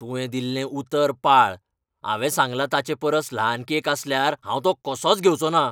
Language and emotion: Goan Konkani, angry